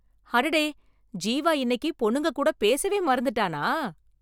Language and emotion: Tamil, surprised